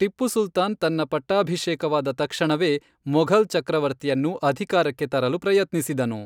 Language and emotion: Kannada, neutral